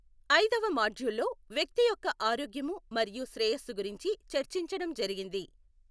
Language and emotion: Telugu, neutral